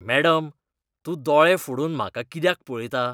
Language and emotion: Goan Konkani, disgusted